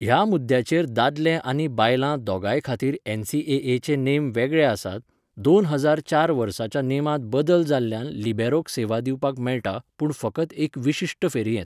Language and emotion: Goan Konkani, neutral